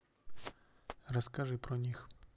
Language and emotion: Russian, neutral